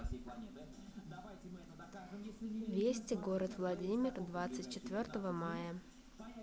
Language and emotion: Russian, neutral